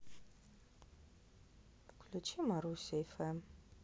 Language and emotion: Russian, neutral